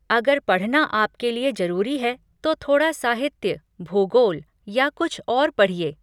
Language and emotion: Hindi, neutral